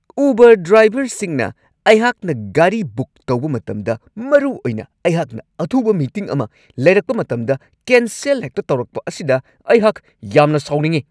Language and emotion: Manipuri, angry